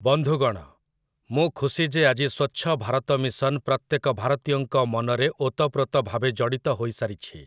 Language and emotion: Odia, neutral